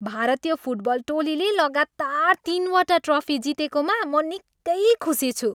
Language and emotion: Nepali, happy